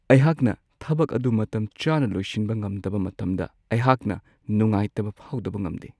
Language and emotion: Manipuri, sad